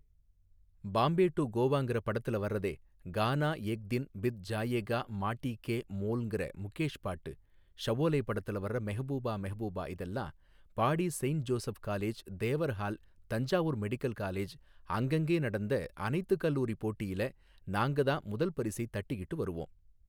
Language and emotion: Tamil, neutral